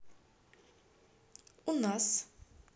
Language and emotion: Russian, positive